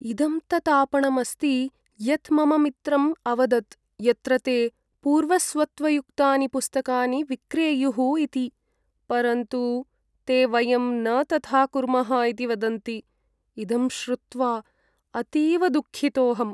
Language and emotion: Sanskrit, sad